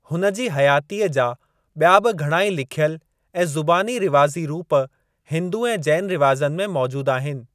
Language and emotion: Sindhi, neutral